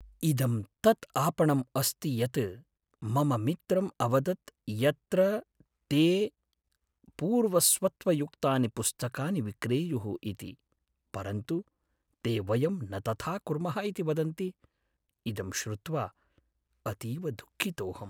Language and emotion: Sanskrit, sad